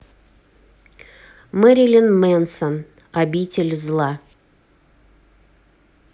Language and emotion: Russian, neutral